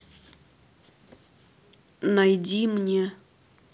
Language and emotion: Russian, neutral